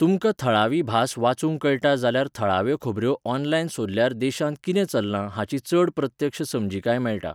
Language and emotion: Goan Konkani, neutral